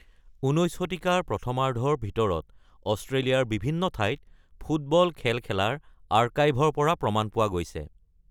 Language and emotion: Assamese, neutral